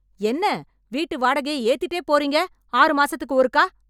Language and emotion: Tamil, angry